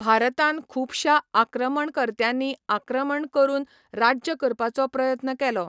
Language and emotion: Goan Konkani, neutral